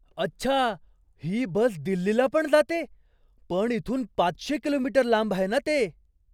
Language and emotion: Marathi, surprised